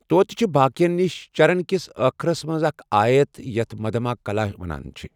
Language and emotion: Kashmiri, neutral